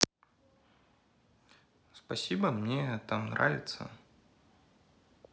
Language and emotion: Russian, neutral